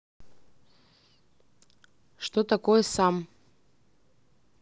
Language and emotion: Russian, neutral